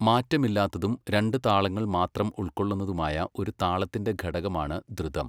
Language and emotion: Malayalam, neutral